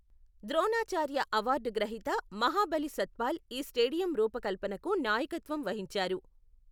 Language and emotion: Telugu, neutral